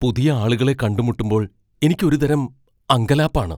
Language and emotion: Malayalam, fearful